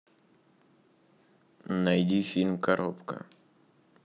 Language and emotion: Russian, neutral